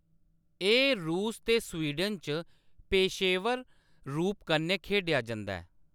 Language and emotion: Dogri, neutral